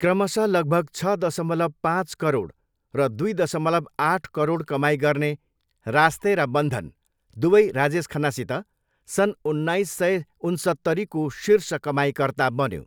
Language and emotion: Nepali, neutral